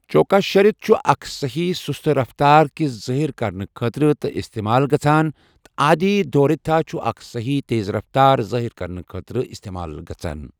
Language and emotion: Kashmiri, neutral